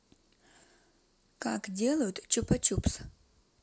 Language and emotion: Russian, neutral